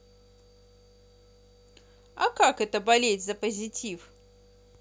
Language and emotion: Russian, positive